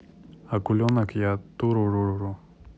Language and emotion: Russian, neutral